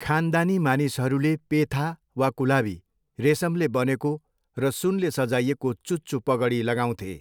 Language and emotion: Nepali, neutral